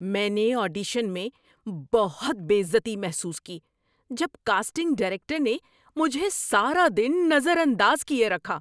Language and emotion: Urdu, angry